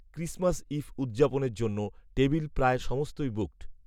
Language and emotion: Bengali, neutral